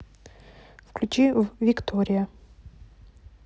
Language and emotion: Russian, neutral